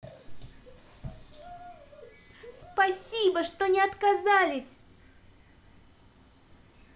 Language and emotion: Russian, positive